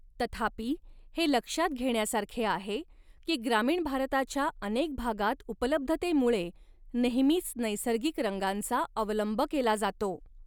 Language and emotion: Marathi, neutral